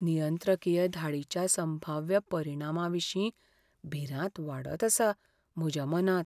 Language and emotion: Goan Konkani, fearful